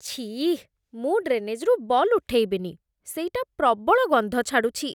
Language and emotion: Odia, disgusted